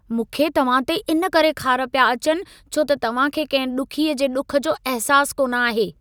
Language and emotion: Sindhi, angry